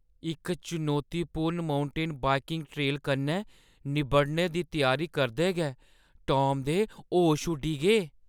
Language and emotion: Dogri, fearful